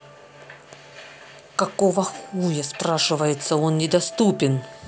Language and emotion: Russian, angry